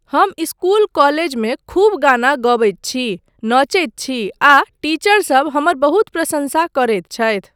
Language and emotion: Maithili, neutral